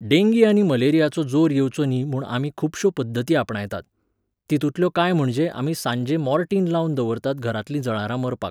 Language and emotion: Goan Konkani, neutral